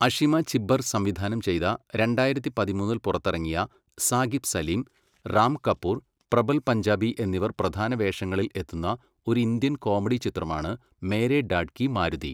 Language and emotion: Malayalam, neutral